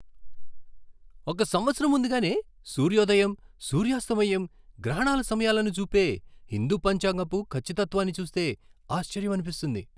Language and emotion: Telugu, surprised